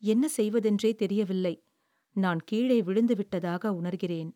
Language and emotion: Tamil, sad